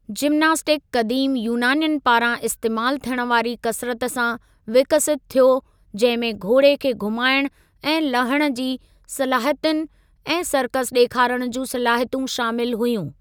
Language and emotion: Sindhi, neutral